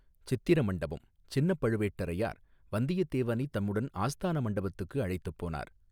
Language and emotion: Tamil, neutral